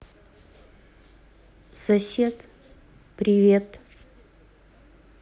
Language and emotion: Russian, neutral